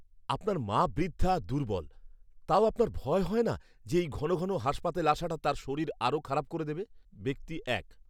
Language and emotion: Bengali, fearful